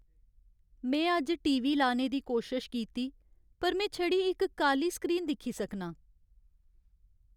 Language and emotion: Dogri, sad